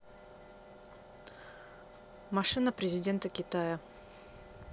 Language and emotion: Russian, neutral